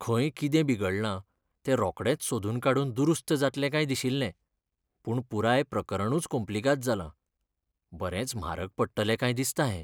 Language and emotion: Goan Konkani, sad